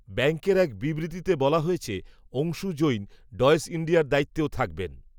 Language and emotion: Bengali, neutral